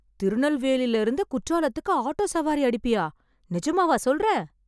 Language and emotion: Tamil, surprised